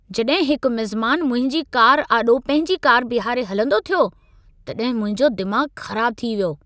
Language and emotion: Sindhi, angry